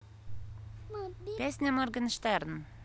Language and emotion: Russian, neutral